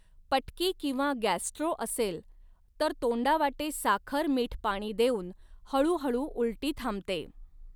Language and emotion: Marathi, neutral